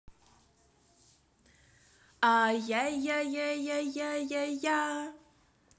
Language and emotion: Russian, positive